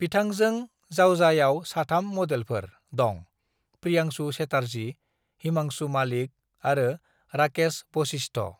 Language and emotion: Bodo, neutral